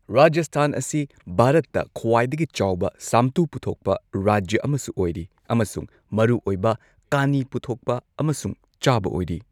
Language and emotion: Manipuri, neutral